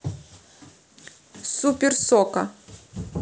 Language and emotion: Russian, neutral